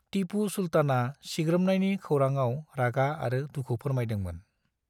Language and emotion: Bodo, neutral